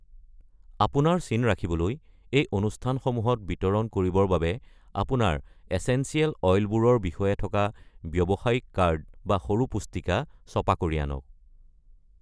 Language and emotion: Assamese, neutral